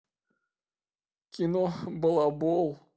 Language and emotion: Russian, positive